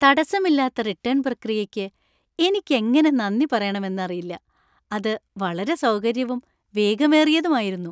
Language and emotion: Malayalam, happy